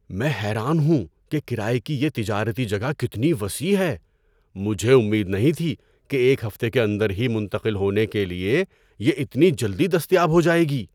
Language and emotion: Urdu, surprised